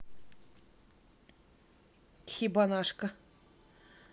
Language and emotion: Russian, neutral